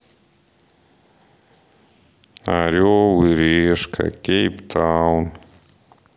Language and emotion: Russian, sad